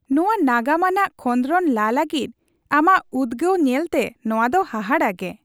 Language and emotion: Santali, happy